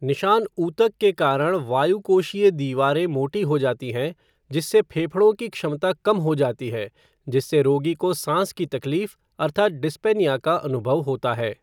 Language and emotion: Hindi, neutral